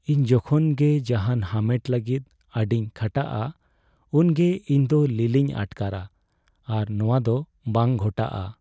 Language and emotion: Santali, sad